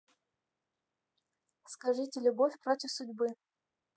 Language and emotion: Russian, neutral